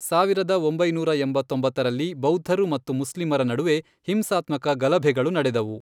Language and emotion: Kannada, neutral